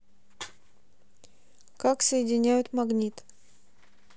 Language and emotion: Russian, neutral